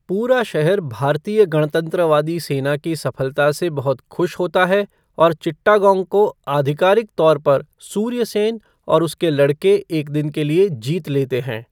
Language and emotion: Hindi, neutral